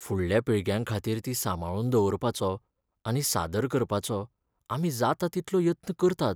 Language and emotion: Goan Konkani, sad